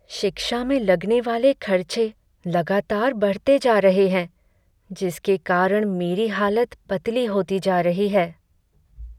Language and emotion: Hindi, sad